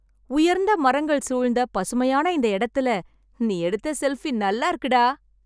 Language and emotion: Tamil, happy